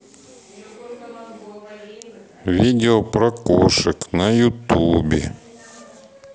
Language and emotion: Russian, neutral